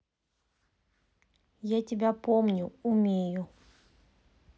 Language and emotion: Russian, neutral